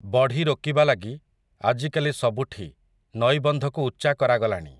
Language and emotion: Odia, neutral